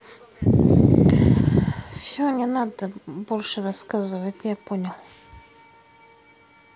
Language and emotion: Russian, sad